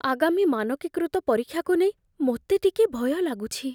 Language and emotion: Odia, fearful